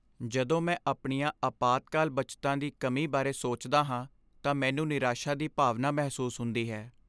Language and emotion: Punjabi, sad